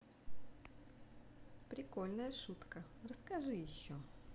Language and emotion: Russian, neutral